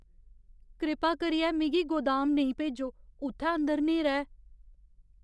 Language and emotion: Dogri, fearful